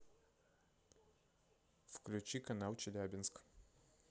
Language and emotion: Russian, neutral